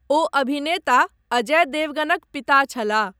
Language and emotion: Maithili, neutral